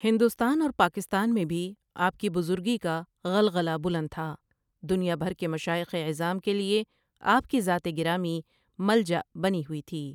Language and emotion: Urdu, neutral